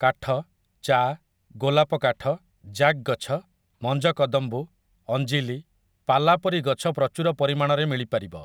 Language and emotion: Odia, neutral